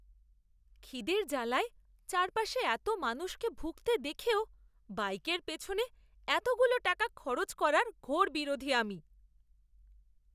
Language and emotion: Bengali, disgusted